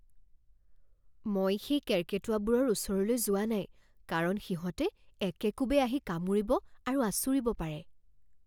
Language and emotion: Assamese, fearful